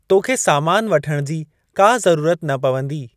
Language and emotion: Sindhi, neutral